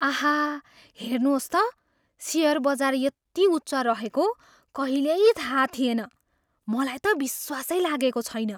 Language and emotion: Nepali, surprised